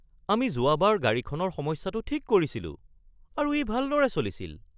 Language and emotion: Assamese, surprised